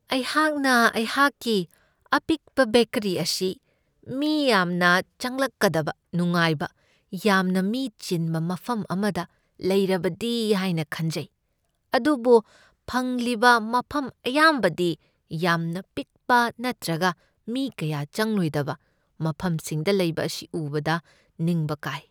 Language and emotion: Manipuri, sad